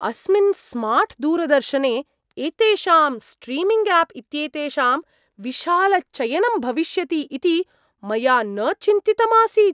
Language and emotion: Sanskrit, surprised